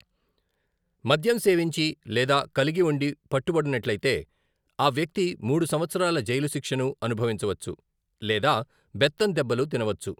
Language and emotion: Telugu, neutral